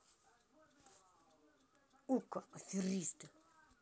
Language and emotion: Russian, angry